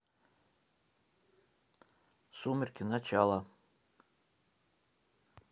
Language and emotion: Russian, neutral